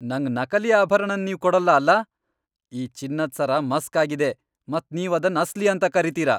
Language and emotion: Kannada, angry